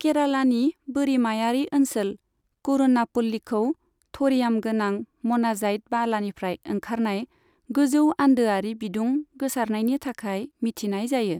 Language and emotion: Bodo, neutral